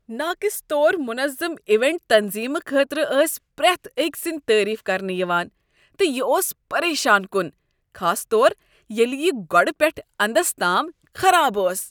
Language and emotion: Kashmiri, disgusted